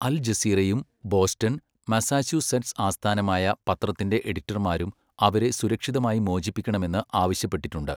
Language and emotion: Malayalam, neutral